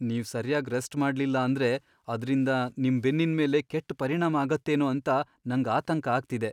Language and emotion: Kannada, fearful